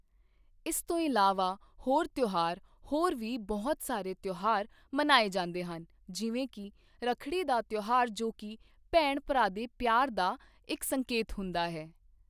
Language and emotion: Punjabi, neutral